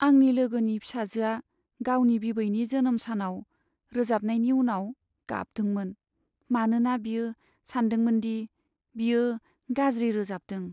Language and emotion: Bodo, sad